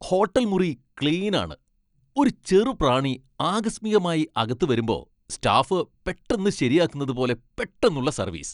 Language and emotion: Malayalam, happy